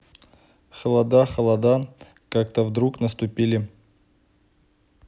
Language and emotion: Russian, neutral